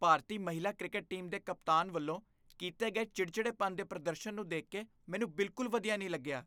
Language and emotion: Punjabi, disgusted